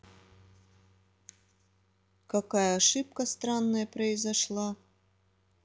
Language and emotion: Russian, neutral